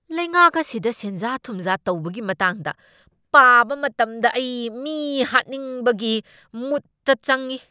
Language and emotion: Manipuri, angry